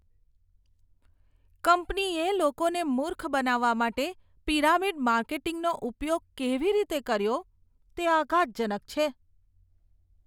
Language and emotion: Gujarati, disgusted